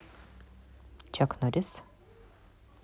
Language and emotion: Russian, neutral